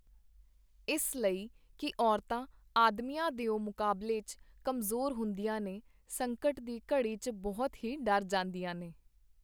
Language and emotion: Punjabi, neutral